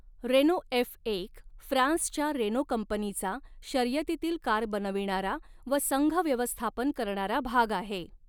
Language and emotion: Marathi, neutral